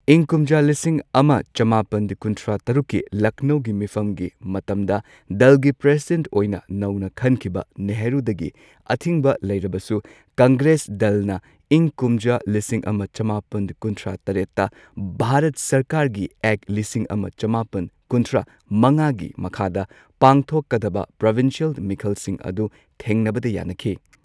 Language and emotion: Manipuri, neutral